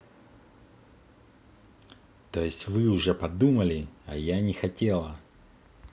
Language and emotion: Russian, angry